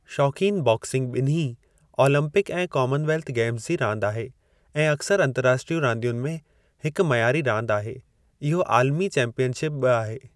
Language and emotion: Sindhi, neutral